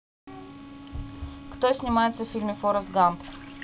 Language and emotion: Russian, neutral